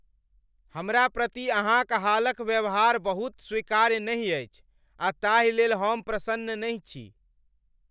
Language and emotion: Maithili, angry